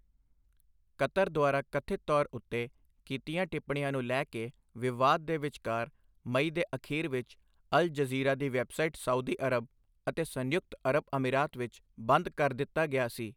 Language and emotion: Punjabi, neutral